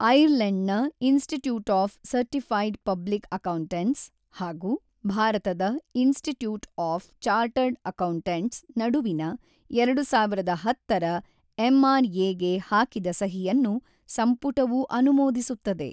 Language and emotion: Kannada, neutral